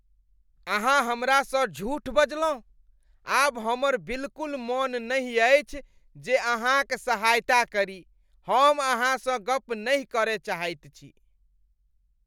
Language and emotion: Maithili, disgusted